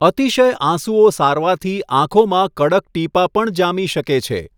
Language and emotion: Gujarati, neutral